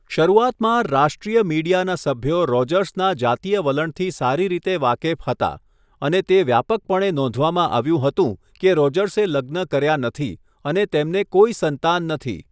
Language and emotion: Gujarati, neutral